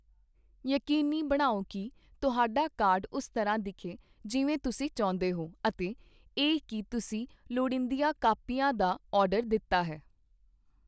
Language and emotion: Punjabi, neutral